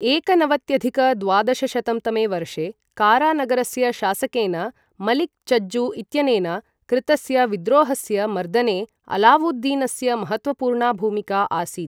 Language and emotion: Sanskrit, neutral